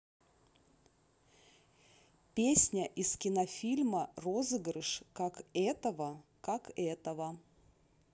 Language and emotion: Russian, neutral